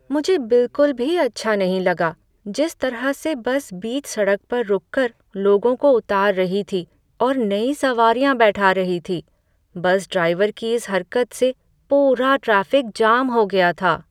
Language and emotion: Hindi, sad